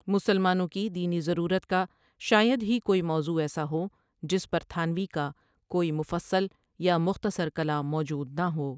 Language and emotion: Urdu, neutral